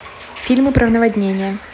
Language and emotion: Russian, neutral